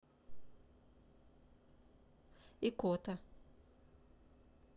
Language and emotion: Russian, neutral